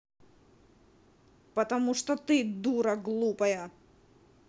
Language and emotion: Russian, angry